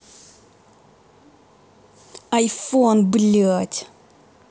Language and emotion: Russian, angry